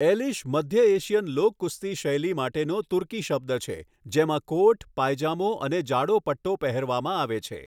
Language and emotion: Gujarati, neutral